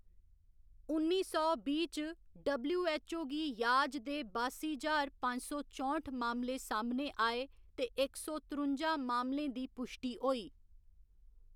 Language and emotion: Dogri, neutral